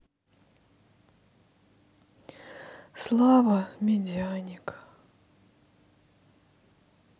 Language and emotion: Russian, sad